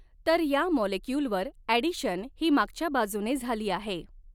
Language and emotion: Marathi, neutral